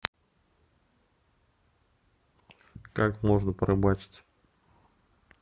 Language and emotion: Russian, neutral